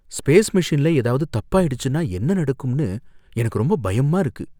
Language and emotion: Tamil, fearful